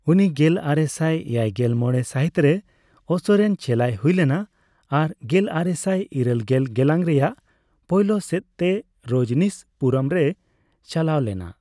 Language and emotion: Santali, neutral